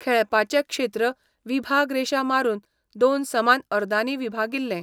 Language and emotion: Goan Konkani, neutral